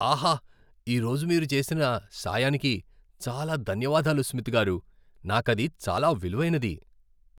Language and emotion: Telugu, happy